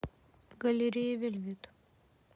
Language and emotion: Russian, neutral